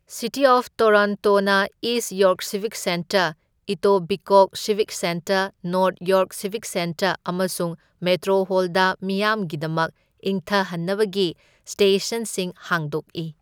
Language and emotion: Manipuri, neutral